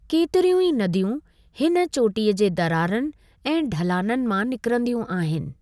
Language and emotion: Sindhi, neutral